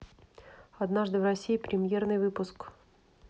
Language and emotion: Russian, neutral